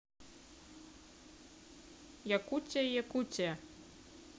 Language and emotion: Russian, neutral